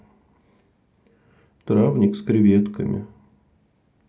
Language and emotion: Russian, sad